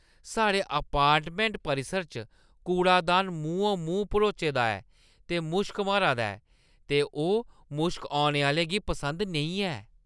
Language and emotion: Dogri, disgusted